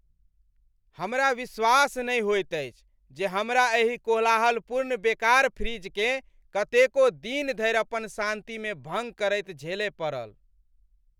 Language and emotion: Maithili, angry